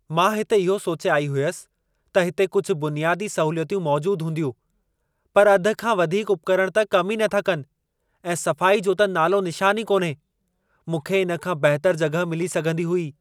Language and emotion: Sindhi, angry